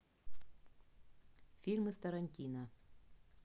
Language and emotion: Russian, neutral